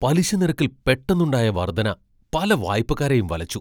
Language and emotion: Malayalam, surprised